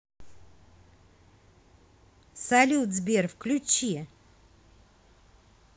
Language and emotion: Russian, positive